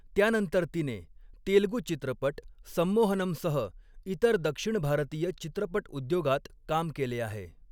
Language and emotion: Marathi, neutral